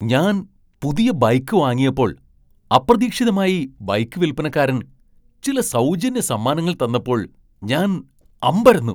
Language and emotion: Malayalam, surprised